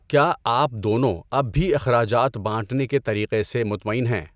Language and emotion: Urdu, neutral